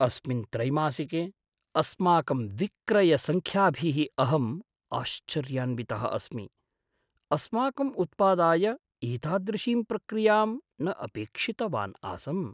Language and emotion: Sanskrit, surprised